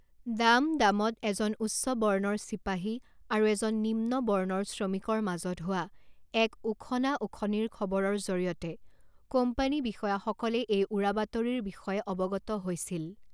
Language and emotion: Assamese, neutral